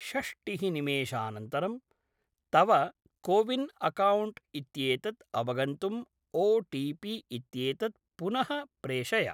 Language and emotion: Sanskrit, neutral